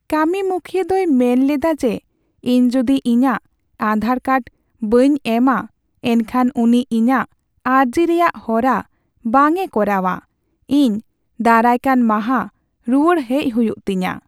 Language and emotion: Santali, sad